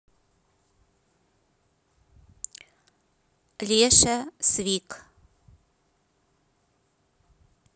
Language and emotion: Russian, neutral